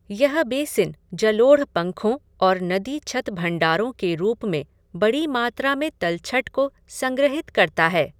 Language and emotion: Hindi, neutral